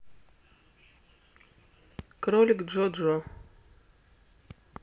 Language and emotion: Russian, neutral